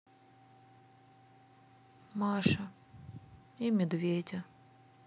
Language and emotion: Russian, sad